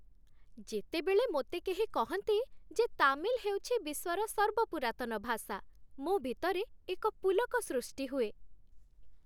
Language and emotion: Odia, happy